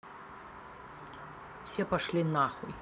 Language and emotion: Russian, angry